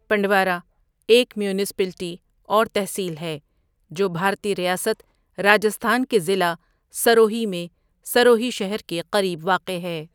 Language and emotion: Urdu, neutral